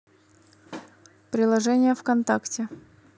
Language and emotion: Russian, neutral